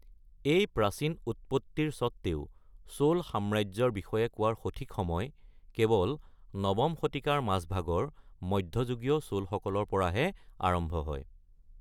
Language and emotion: Assamese, neutral